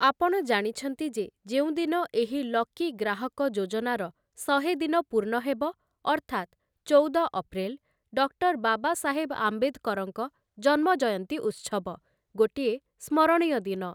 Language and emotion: Odia, neutral